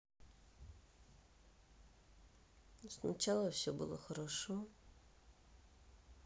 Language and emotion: Russian, sad